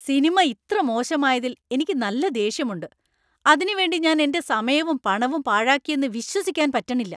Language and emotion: Malayalam, angry